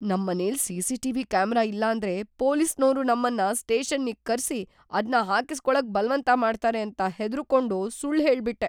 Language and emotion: Kannada, fearful